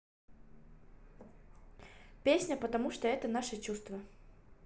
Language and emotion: Russian, neutral